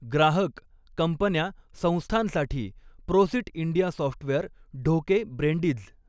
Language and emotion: Marathi, neutral